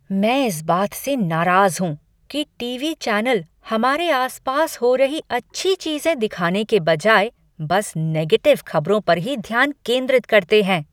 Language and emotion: Hindi, angry